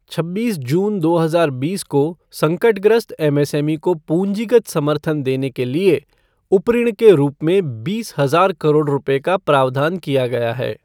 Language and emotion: Hindi, neutral